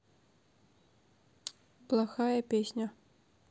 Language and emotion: Russian, neutral